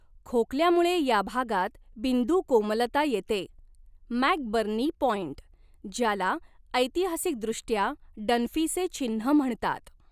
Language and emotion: Marathi, neutral